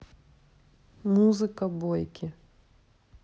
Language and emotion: Russian, neutral